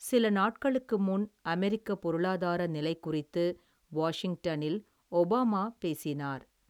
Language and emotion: Tamil, neutral